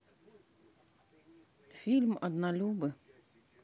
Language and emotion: Russian, neutral